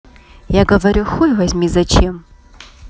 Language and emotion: Russian, neutral